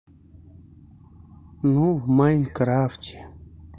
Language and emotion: Russian, sad